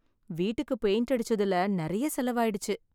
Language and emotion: Tamil, sad